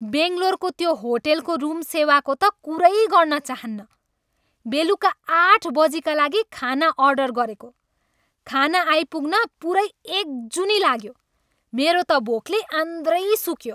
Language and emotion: Nepali, angry